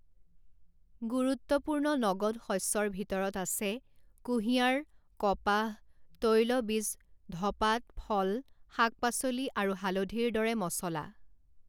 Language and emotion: Assamese, neutral